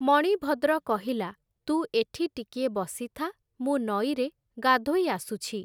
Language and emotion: Odia, neutral